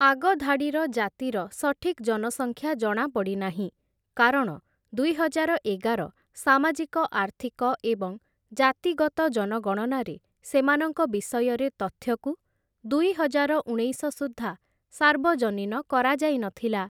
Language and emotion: Odia, neutral